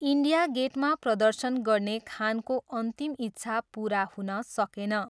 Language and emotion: Nepali, neutral